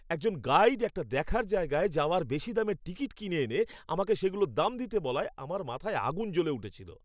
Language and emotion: Bengali, angry